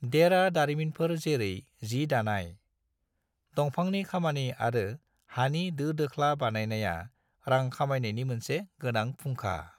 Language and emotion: Bodo, neutral